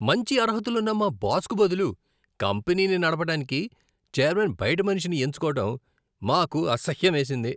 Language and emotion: Telugu, disgusted